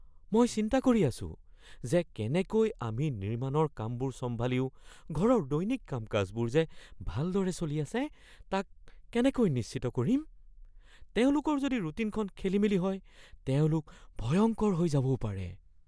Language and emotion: Assamese, fearful